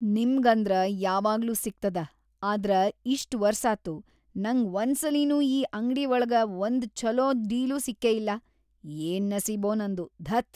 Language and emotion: Kannada, disgusted